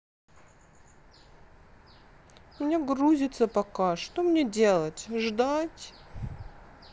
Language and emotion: Russian, sad